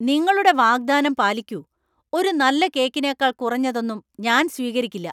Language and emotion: Malayalam, angry